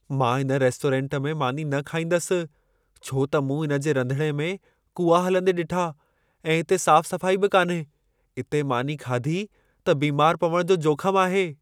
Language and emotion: Sindhi, fearful